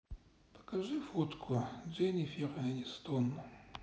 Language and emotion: Russian, sad